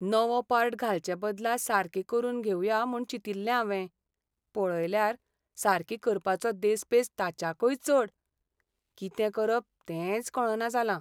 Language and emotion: Goan Konkani, sad